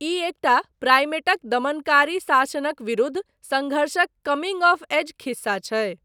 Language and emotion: Maithili, neutral